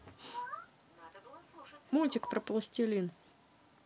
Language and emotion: Russian, neutral